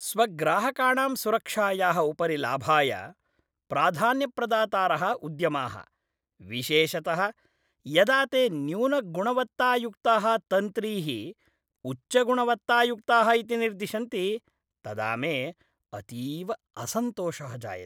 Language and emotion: Sanskrit, disgusted